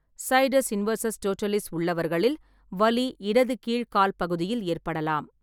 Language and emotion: Tamil, neutral